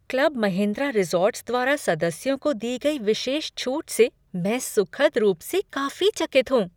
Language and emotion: Hindi, surprised